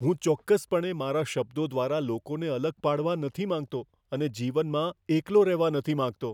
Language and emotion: Gujarati, fearful